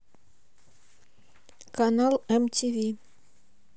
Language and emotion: Russian, neutral